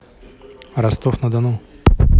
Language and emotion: Russian, neutral